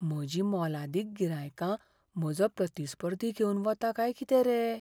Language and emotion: Goan Konkani, fearful